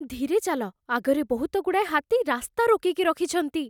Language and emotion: Odia, fearful